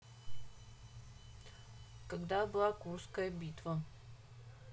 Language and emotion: Russian, neutral